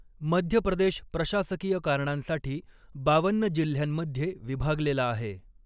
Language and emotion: Marathi, neutral